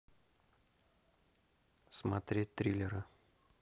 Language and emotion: Russian, neutral